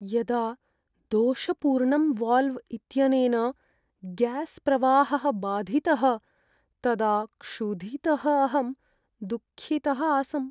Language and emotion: Sanskrit, sad